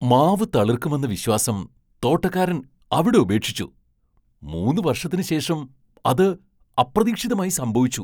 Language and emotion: Malayalam, surprised